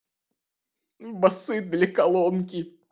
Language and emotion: Russian, sad